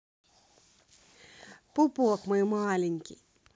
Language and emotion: Russian, positive